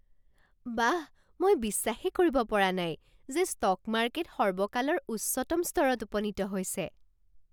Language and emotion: Assamese, surprised